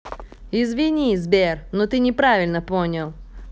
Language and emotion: Russian, neutral